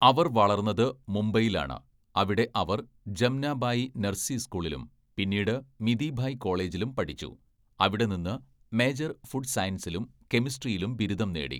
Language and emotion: Malayalam, neutral